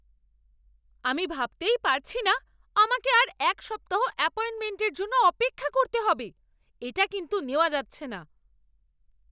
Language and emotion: Bengali, angry